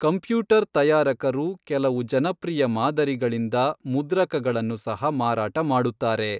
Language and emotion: Kannada, neutral